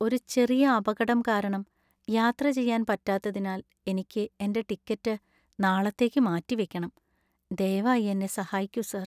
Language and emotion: Malayalam, sad